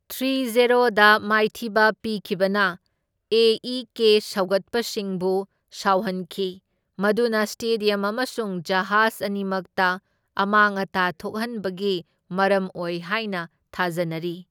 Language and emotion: Manipuri, neutral